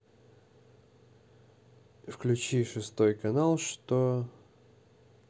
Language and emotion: Russian, neutral